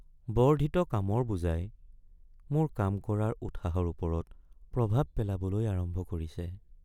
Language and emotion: Assamese, sad